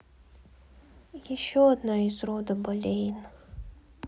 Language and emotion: Russian, sad